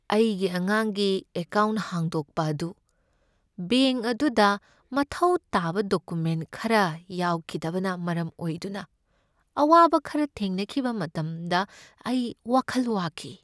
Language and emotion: Manipuri, sad